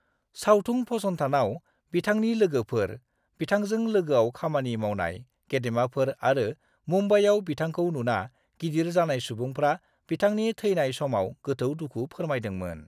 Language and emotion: Bodo, neutral